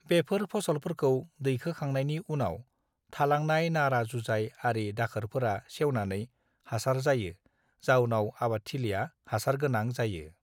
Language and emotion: Bodo, neutral